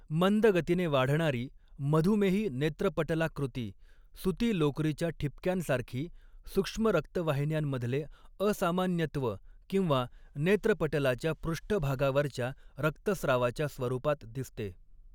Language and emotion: Marathi, neutral